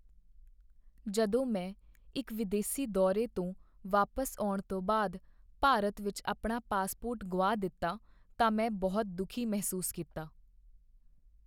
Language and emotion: Punjabi, sad